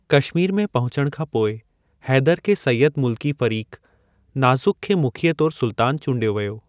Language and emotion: Sindhi, neutral